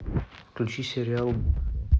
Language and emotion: Russian, neutral